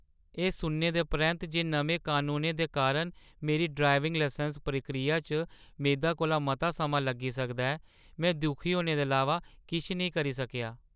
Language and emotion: Dogri, sad